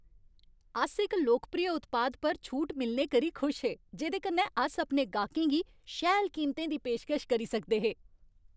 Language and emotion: Dogri, happy